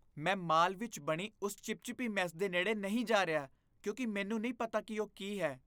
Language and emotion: Punjabi, disgusted